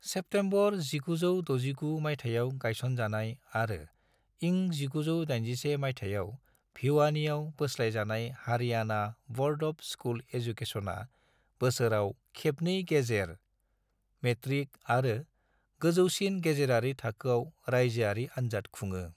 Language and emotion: Bodo, neutral